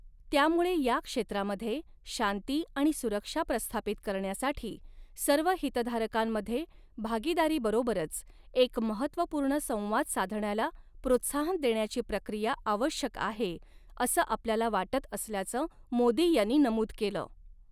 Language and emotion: Marathi, neutral